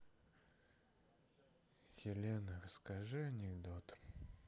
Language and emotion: Russian, sad